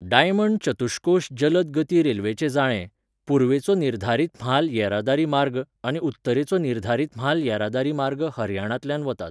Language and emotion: Goan Konkani, neutral